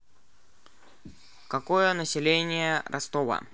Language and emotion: Russian, neutral